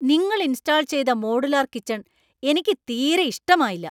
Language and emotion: Malayalam, angry